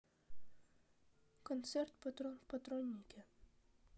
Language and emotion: Russian, sad